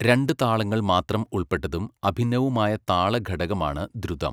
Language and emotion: Malayalam, neutral